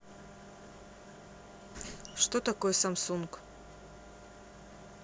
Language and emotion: Russian, neutral